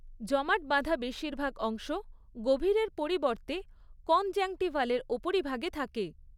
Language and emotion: Bengali, neutral